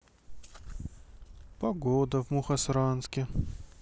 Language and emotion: Russian, sad